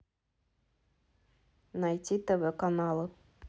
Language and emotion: Russian, neutral